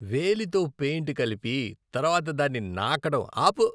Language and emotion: Telugu, disgusted